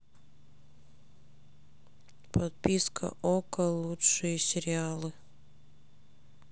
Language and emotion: Russian, sad